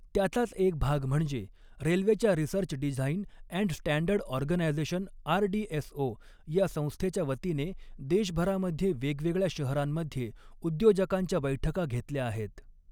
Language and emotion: Marathi, neutral